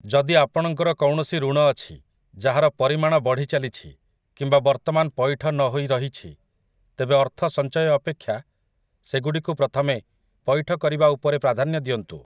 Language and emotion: Odia, neutral